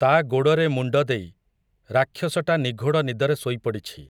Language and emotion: Odia, neutral